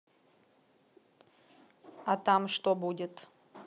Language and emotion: Russian, neutral